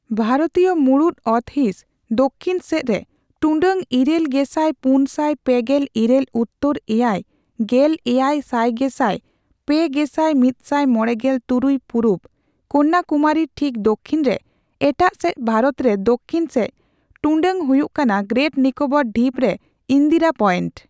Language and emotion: Santali, neutral